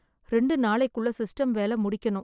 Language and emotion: Tamil, sad